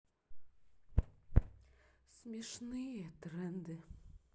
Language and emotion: Russian, sad